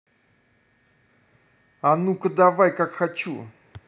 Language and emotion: Russian, angry